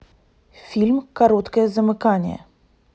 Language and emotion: Russian, neutral